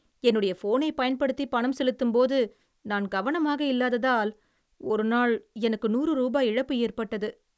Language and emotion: Tamil, sad